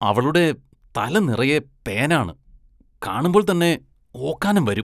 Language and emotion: Malayalam, disgusted